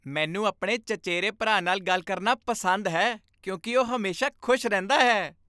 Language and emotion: Punjabi, happy